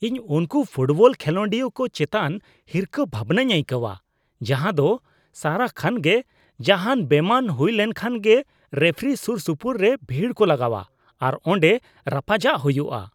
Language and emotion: Santali, disgusted